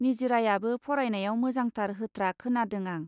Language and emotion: Bodo, neutral